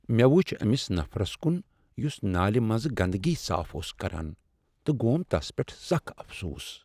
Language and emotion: Kashmiri, sad